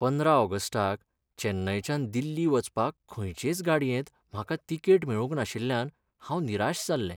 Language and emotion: Goan Konkani, sad